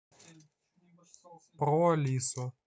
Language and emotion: Russian, neutral